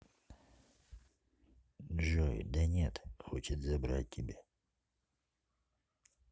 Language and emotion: Russian, neutral